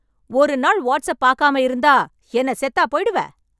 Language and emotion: Tamil, angry